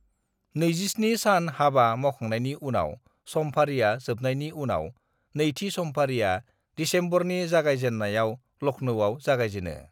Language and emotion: Bodo, neutral